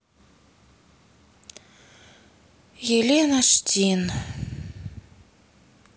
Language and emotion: Russian, sad